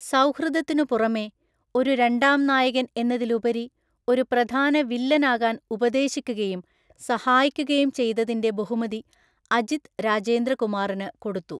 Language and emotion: Malayalam, neutral